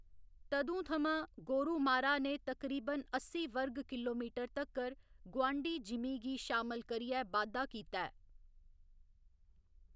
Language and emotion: Dogri, neutral